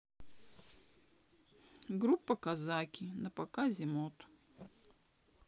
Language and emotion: Russian, sad